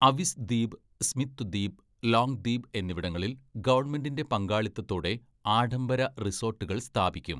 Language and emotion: Malayalam, neutral